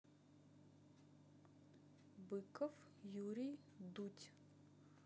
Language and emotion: Russian, neutral